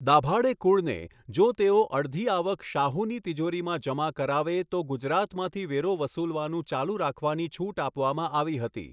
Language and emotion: Gujarati, neutral